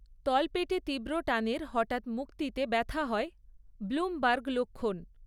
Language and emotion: Bengali, neutral